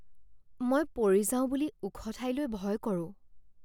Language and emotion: Assamese, fearful